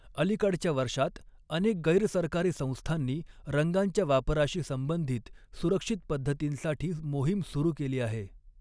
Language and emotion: Marathi, neutral